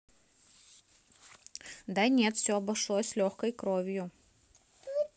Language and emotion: Russian, neutral